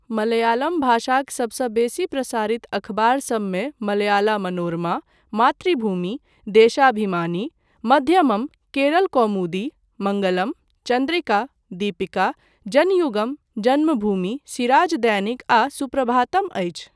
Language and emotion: Maithili, neutral